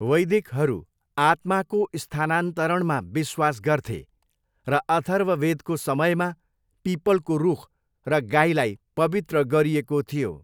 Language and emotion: Nepali, neutral